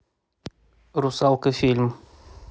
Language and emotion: Russian, neutral